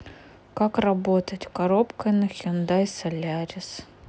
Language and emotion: Russian, sad